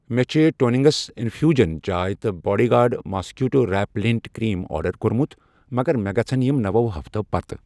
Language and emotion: Kashmiri, neutral